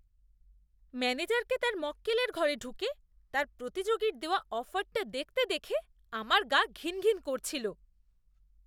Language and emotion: Bengali, disgusted